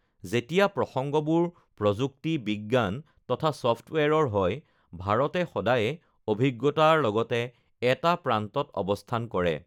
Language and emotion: Assamese, neutral